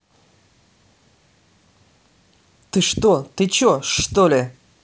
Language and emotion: Russian, angry